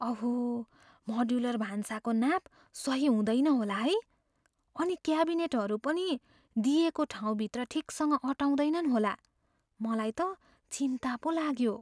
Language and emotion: Nepali, fearful